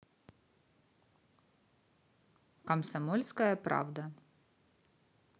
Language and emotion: Russian, neutral